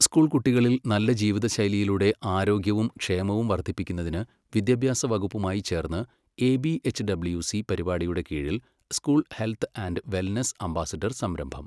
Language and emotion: Malayalam, neutral